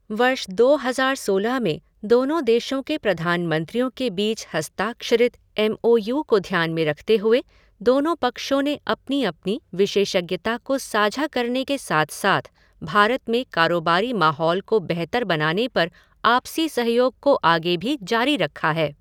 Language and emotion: Hindi, neutral